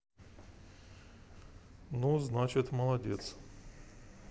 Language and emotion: Russian, neutral